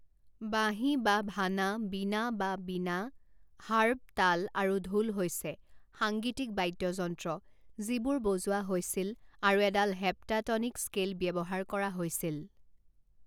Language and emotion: Assamese, neutral